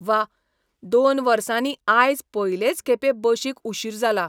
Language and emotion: Goan Konkani, surprised